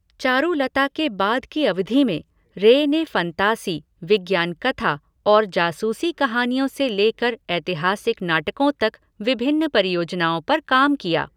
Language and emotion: Hindi, neutral